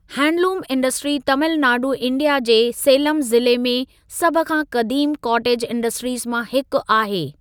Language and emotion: Sindhi, neutral